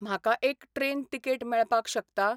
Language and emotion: Goan Konkani, neutral